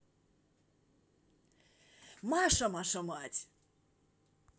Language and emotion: Russian, positive